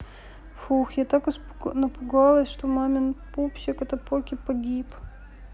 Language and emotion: Russian, sad